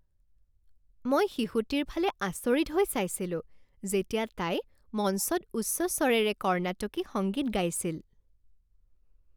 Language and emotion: Assamese, happy